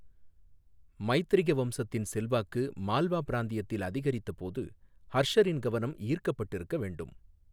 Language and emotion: Tamil, neutral